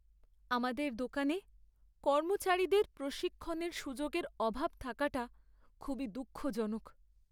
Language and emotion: Bengali, sad